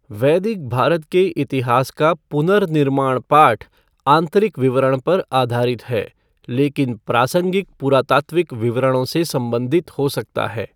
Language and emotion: Hindi, neutral